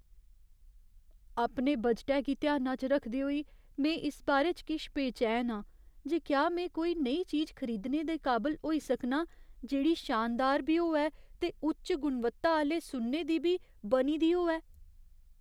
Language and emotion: Dogri, fearful